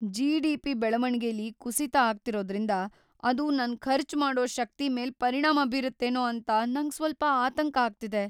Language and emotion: Kannada, fearful